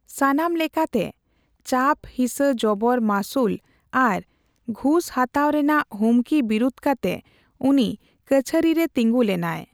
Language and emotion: Santali, neutral